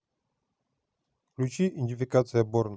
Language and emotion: Russian, neutral